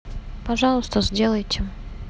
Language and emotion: Russian, neutral